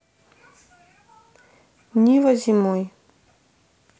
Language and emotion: Russian, neutral